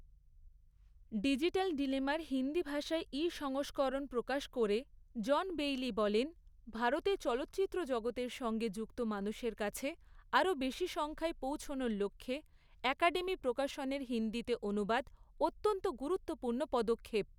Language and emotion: Bengali, neutral